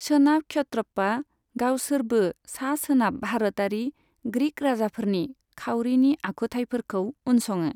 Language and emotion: Bodo, neutral